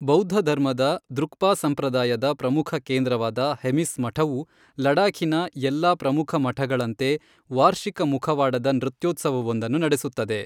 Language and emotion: Kannada, neutral